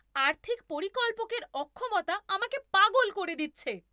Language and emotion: Bengali, angry